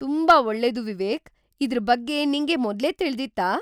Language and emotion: Kannada, surprised